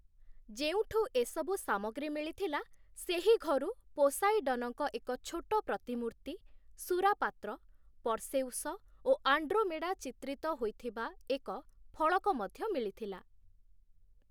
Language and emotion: Odia, neutral